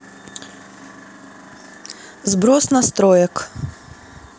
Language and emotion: Russian, neutral